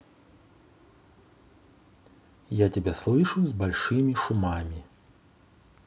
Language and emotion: Russian, neutral